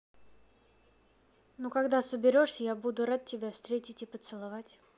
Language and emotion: Russian, neutral